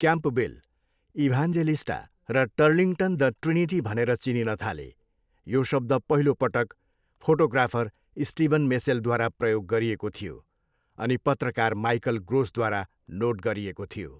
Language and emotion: Nepali, neutral